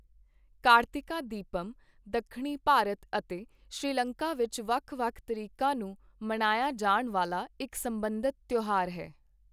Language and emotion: Punjabi, neutral